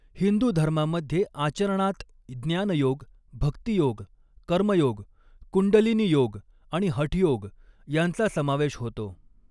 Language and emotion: Marathi, neutral